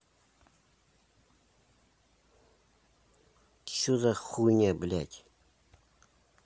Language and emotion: Russian, angry